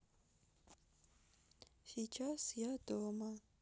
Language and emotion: Russian, sad